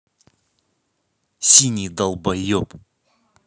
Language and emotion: Russian, angry